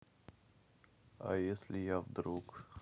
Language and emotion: Russian, neutral